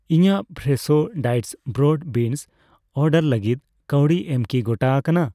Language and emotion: Santali, neutral